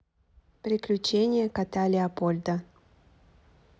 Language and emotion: Russian, neutral